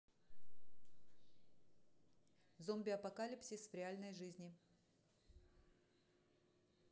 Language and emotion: Russian, neutral